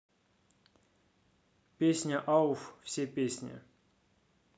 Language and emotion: Russian, neutral